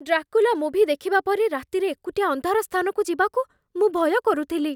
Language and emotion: Odia, fearful